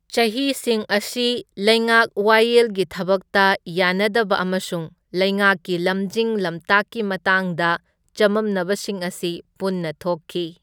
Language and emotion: Manipuri, neutral